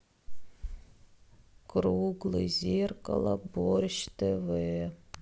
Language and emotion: Russian, sad